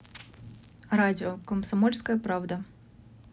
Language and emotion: Russian, neutral